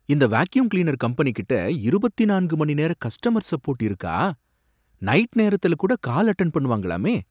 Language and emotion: Tamil, surprised